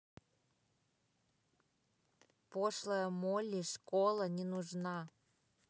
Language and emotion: Russian, neutral